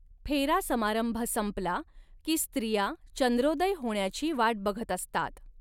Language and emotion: Marathi, neutral